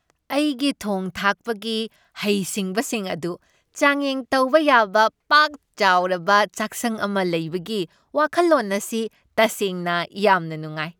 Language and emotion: Manipuri, happy